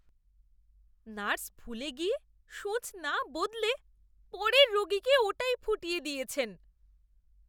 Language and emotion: Bengali, disgusted